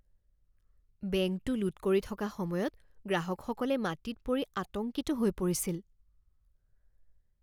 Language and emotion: Assamese, fearful